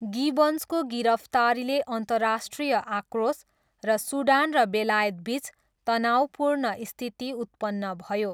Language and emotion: Nepali, neutral